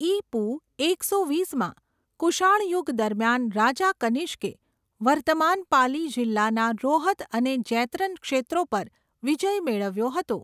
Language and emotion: Gujarati, neutral